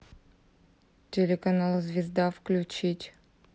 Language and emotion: Russian, neutral